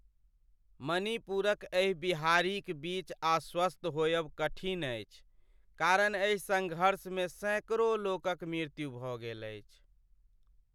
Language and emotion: Maithili, sad